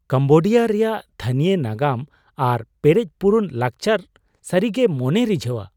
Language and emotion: Santali, surprised